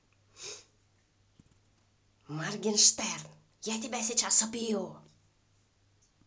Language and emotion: Russian, angry